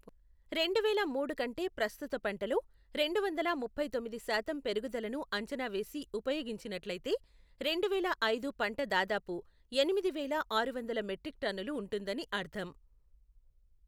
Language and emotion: Telugu, neutral